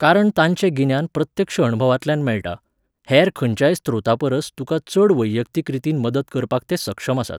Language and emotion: Goan Konkani, neutral